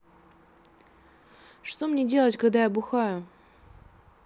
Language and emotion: Russian, neutral